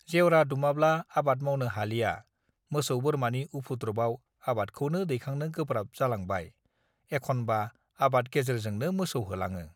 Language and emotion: Bodo, neutral